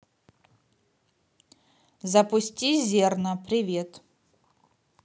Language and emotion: Russian, neutral